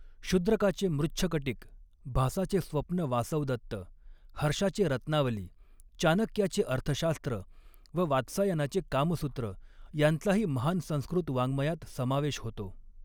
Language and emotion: Marathi, neutral